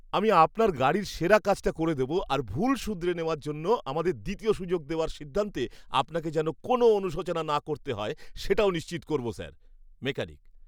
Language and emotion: Bengali, happy